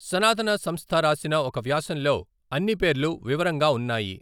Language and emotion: Telugu, neutral